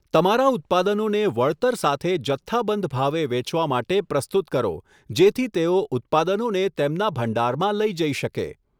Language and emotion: Gujarati, neutral